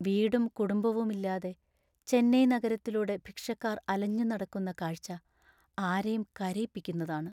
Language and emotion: Malayalam, sad